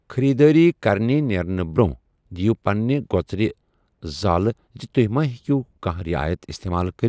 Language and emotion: Kashmiri, neutral